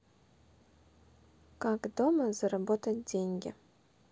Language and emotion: Russian, neutral